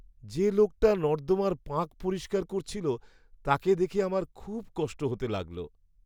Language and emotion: Bengali, sad